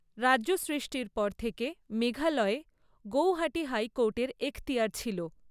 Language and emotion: Bengali, neutral